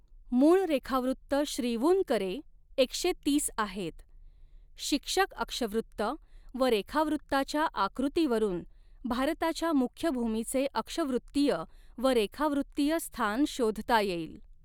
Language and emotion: Marathi, neutral